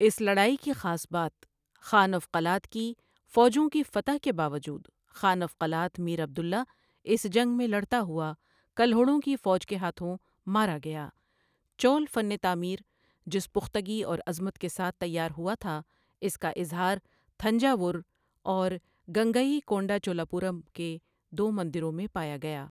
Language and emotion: Urdu, neutral